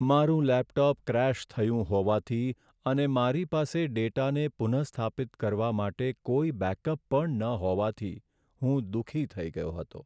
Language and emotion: Gujarati, sad